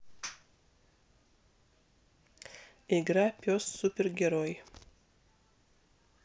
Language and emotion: Russian, neutral